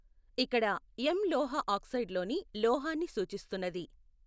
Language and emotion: Telugu, neutral